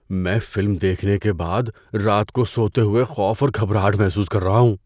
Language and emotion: Urdu, fearful